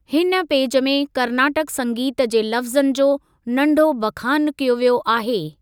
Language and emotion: Sindhi, neutral